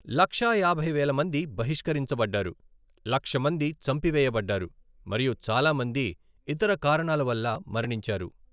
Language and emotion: Telugu, neutral